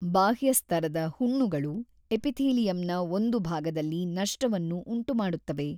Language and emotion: Kannada, neutral